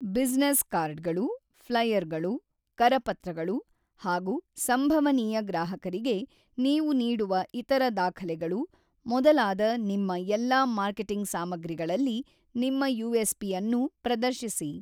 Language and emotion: Kannada, neutral